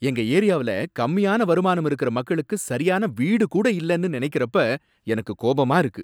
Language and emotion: Tamil, angry